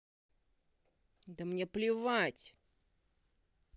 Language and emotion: Russian, angry